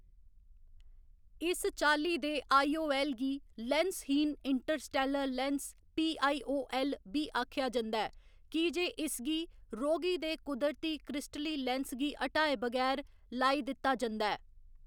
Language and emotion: Dogri, neutral